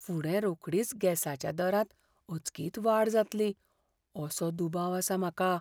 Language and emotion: Goan Konkani, fearful